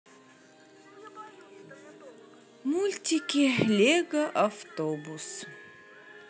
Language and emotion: Russian, sad